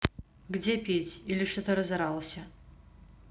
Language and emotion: Russian, neutral